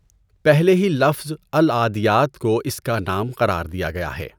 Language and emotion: Urdu, neutral